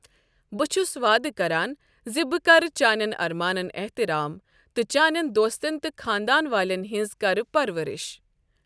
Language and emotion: Kashmiri, neutral